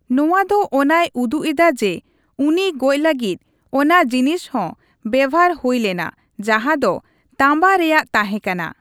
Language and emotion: Santali, neutral